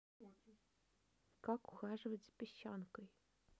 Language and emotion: Russian, neutral